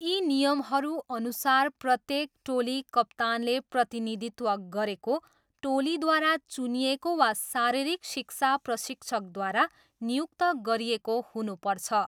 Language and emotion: Nepali, neutral